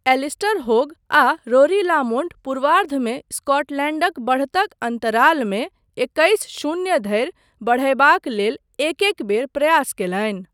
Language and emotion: Maithili, neutral